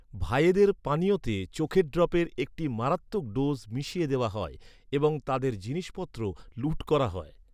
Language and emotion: Bengali, neutral